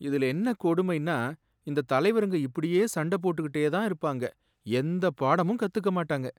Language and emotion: Tamil, sad